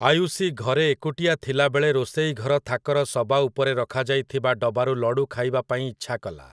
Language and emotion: Odia, neutral